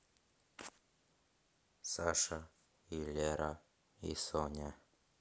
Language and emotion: Russian, neutral